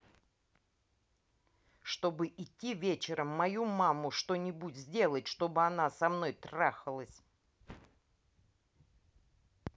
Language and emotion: Russian, angry